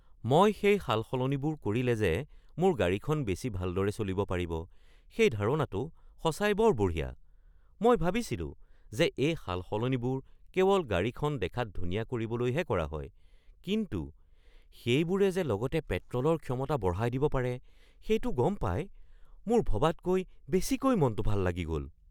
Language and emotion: Assamese, surprised